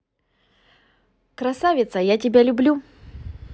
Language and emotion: Russian, positive